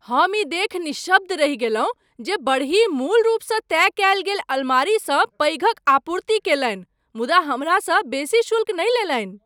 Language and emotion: Maithili, surprised